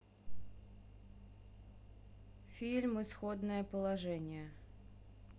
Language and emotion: Russian, neutral